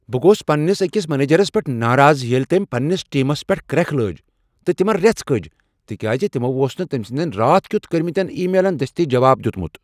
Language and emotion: Kashmiri, angry